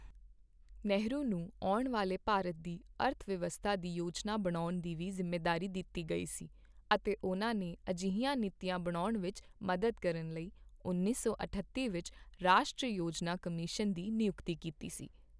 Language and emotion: Punjabi, neutral